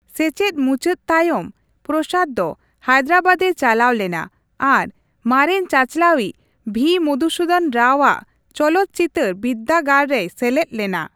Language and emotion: Santali, neutral